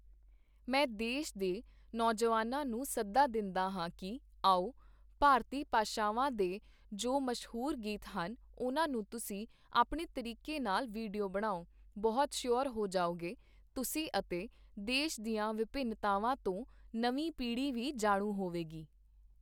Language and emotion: Punjabi, neutral